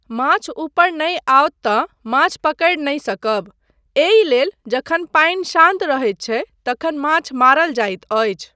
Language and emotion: Maithili, neutral